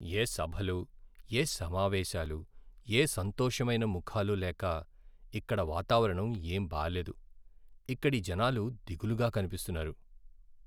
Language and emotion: Telugu, sad